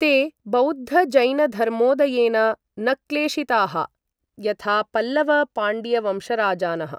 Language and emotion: Sanskrit, neutral